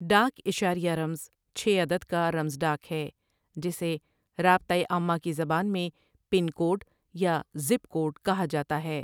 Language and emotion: Urdu, neutral